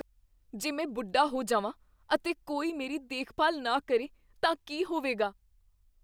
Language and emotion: Punjabi, fearful